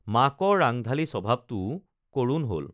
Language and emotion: Assamese, neutral